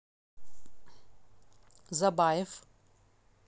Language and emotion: Russian, neutral